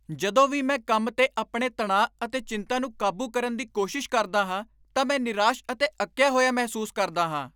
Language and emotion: Punjabi, angry